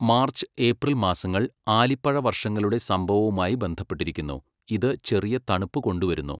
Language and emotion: Malayalam, neutral